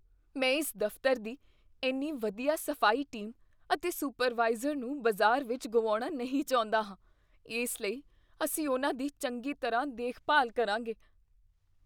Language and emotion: Punjabi, fearful